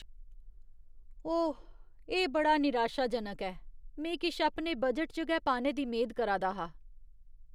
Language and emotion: Dogri, disgusted